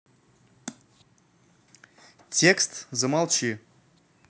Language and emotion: Russian, neutral